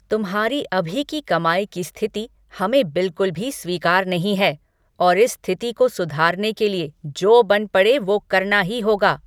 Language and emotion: Hindi, angry